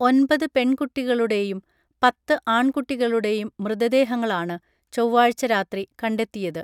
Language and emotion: Malayalam, neutral